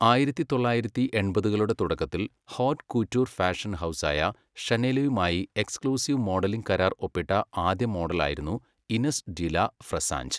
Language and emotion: Malayalam, neutral